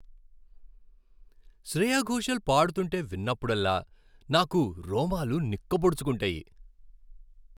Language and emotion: Telugu, happy